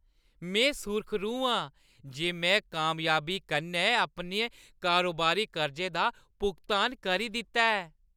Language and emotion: Dogri, happy